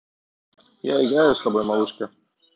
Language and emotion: Russian, neutral